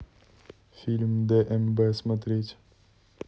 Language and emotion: Russian, neutral